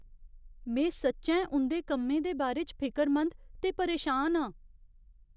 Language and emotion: Dogri, fearful